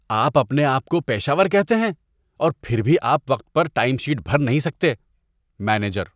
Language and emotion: Urdu, disgusted